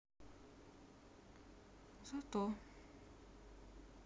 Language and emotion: Russian, sad